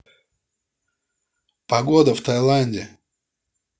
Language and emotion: Russian, neutral